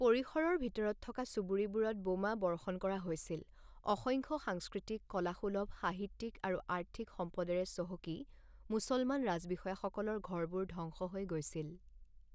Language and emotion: Assamese, neutral